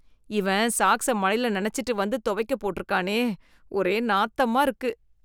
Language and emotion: Tamil, disgusted